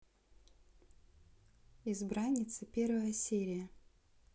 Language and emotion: Russian, neutral